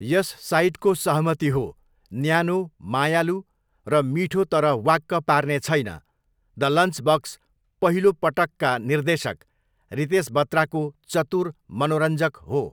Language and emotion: Nepali, neutral